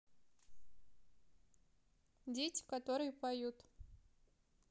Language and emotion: Russian, neutral